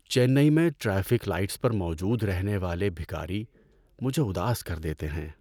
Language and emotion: Urdu, sad